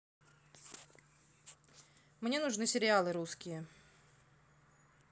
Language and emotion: Russian, neutral